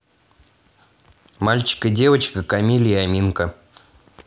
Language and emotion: Russian, neutral